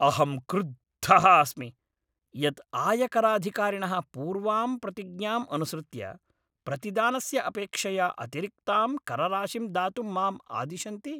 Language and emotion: Sanskrit, angry